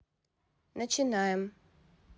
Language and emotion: Russian, neutral